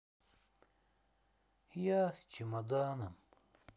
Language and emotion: Russian, sad